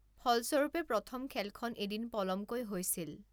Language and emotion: Assamese, neutral